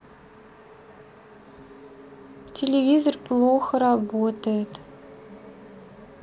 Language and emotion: Russian, sad